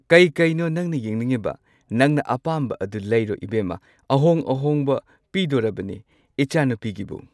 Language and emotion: Manipuri, neutral